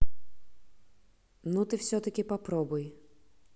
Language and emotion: Russian, neutral